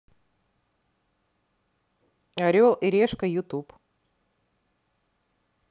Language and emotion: Russian, neutral